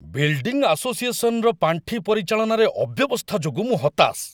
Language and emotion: Odia, angry